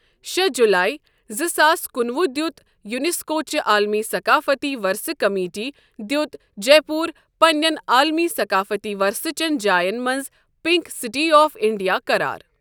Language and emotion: Kashmiri, neutral